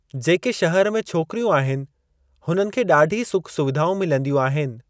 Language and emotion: Sindhi, neutral